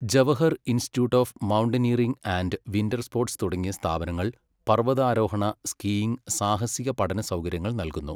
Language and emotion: Malayalam, neutral